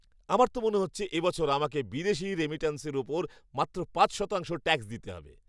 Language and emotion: Bengali, happy